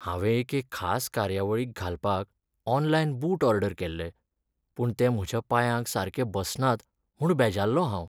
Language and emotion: Goan Konkani, sad